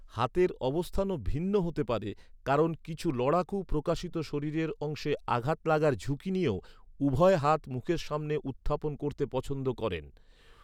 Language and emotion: Bengali, neutral